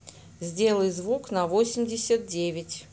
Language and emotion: Russian, neutral